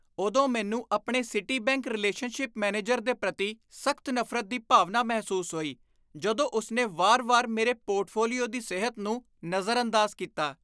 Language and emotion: Punjabi, disgusted